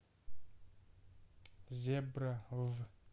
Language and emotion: Russian, neutral